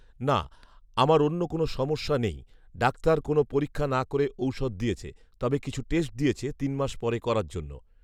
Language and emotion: Bengali, neutral